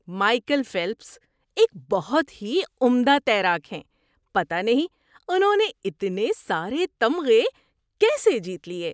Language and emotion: Urdu, surprised